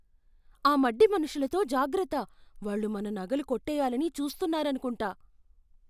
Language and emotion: Telugu, fearful